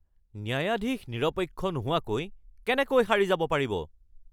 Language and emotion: Assamese, angry